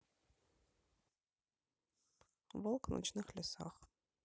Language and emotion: Russian, neutral